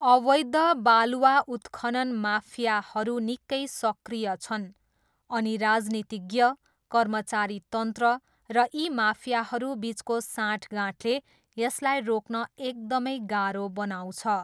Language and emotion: Nepali, neutral